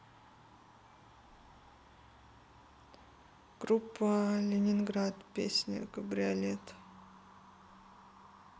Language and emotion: Russian, sad